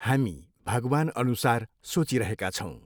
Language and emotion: Nepali, neutral